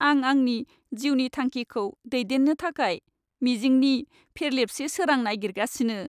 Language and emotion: Bodo, sad